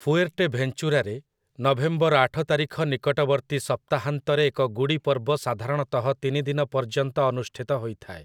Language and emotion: Odia, neutral